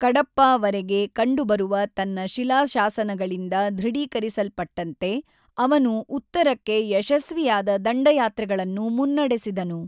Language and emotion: Kannada, neutral